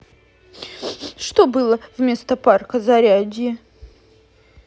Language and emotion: Russian, sad